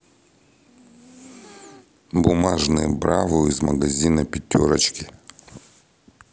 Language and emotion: Russian, neutral